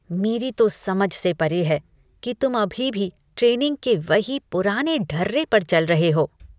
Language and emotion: Hindi, disgusted